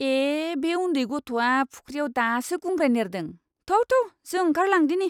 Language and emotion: Bodo, disgusted